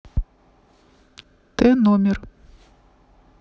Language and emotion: Russian, neutral